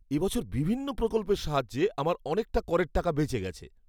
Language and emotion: Bengali, happy